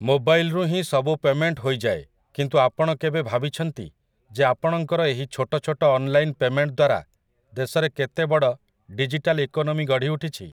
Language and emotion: Odia, neutral